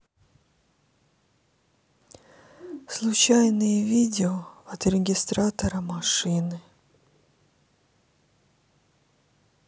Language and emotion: Russian, sad